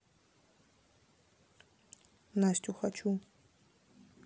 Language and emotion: Russian, neutral